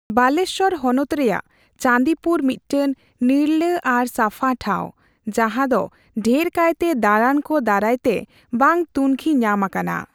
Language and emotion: Santali, neutral